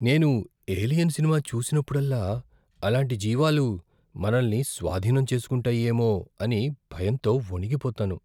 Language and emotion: Telugu, fearful